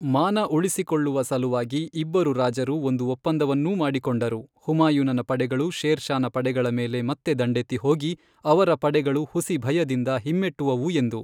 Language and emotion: Kannada, neutral